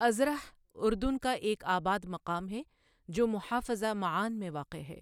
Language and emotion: Urdu, neutral